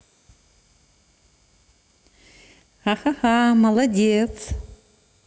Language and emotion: Russian, positive